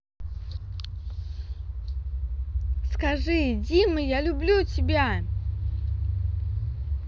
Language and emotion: Russian, angry